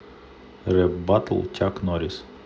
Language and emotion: Russian, neutral